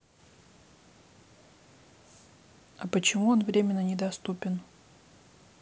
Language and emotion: Russian, neutral